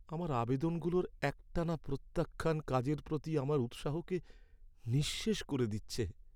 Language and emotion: Bengali, sad